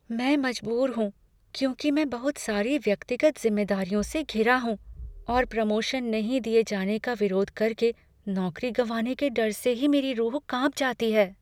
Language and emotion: Hindi, fearful